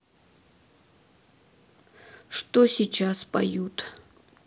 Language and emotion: Russian, neutral